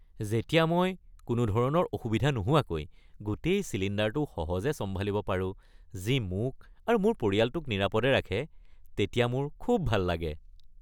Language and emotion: Assamese, happy